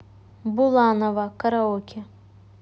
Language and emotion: Russian, neutral